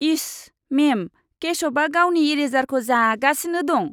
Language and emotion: Bodo, disgusted